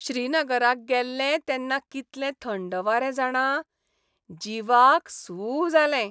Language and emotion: Goan Konkani, happy